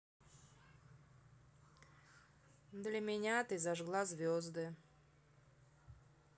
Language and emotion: Russian, neutral